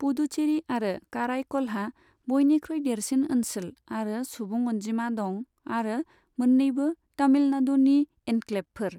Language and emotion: Bodo, neutral